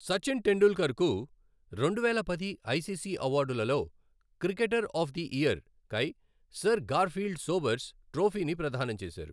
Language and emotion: Telugu, neutral